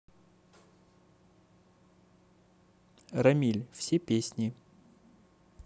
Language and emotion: Russian, neutral